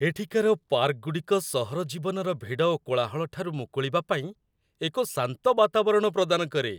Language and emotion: Odia, happy